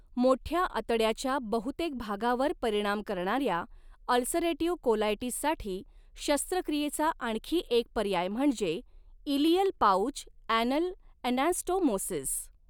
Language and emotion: Marathi, neutral